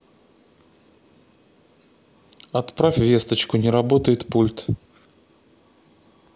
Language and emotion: Russian, neutral